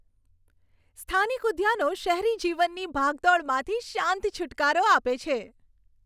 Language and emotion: Gujarati, happy